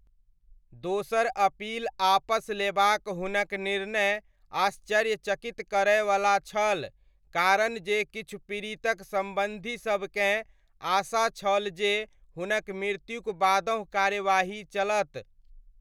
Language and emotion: Maithili, neutral